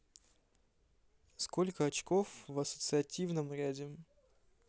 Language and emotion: Russian, neutral